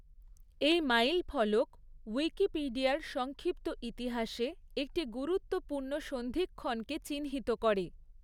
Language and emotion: Bengali, neutral